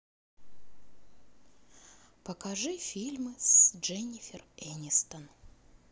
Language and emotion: Russian, neutral